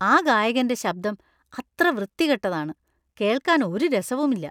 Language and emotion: Malayalam, disgusted